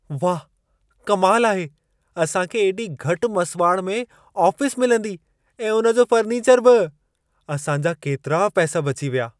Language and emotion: Sindhi, surprised